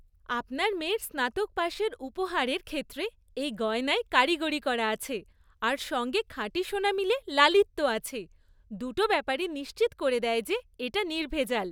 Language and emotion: Bengali, happy